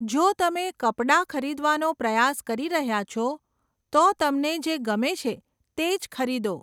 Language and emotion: Gujarati, neutral